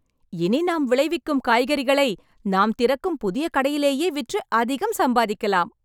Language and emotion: Tamil, happy